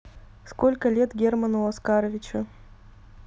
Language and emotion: Russian, neutral